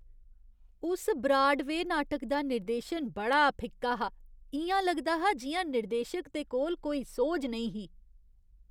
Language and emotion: Dogri, disgusted